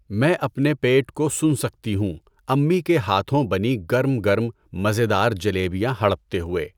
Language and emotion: Urdu, neutral